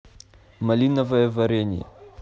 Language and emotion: Russian, neutral